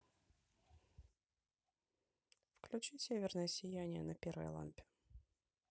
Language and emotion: Russian, neutral